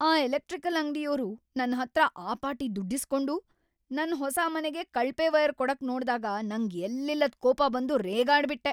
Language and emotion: Kannada, angry